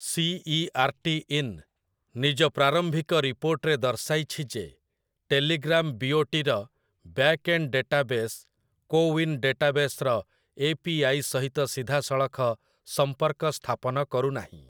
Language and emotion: Odia, neutral